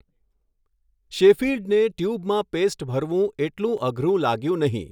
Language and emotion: Gujarati, neutral